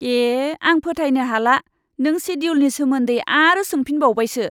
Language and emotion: Bodo, disgusted